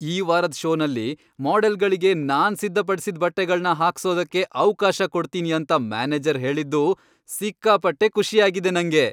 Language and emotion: Kannada, happy